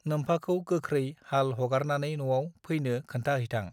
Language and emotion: Bodo, neutral